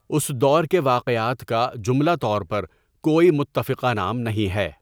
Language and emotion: Urdu, neutral